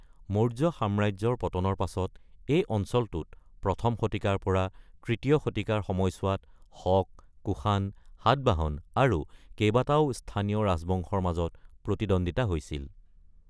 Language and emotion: Assamese, neutral